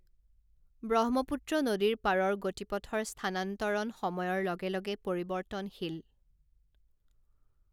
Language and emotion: Assamese, neutral